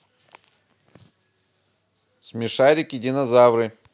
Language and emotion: Russian, positive